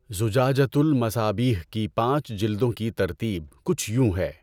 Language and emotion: Urdu, neutral